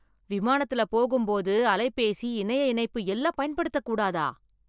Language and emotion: Tamil, surprised